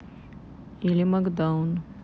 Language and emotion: Russian, neutral